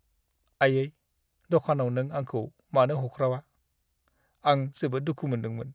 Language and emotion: Bodo, sad